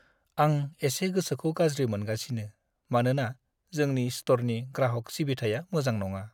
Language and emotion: Bodo, sad